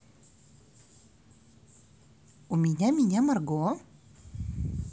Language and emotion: Russian, positive